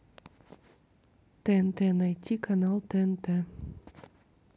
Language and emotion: Russian, neutral